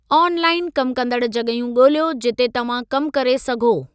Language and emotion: Sindhi, neutral